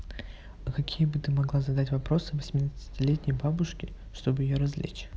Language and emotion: Russian, neutral